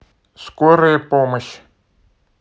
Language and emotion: Russian, neutral